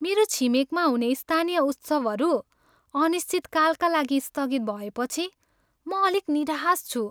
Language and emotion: Nepali, sad